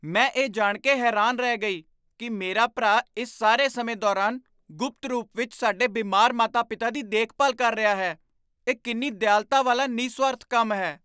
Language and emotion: Punjabi, surprised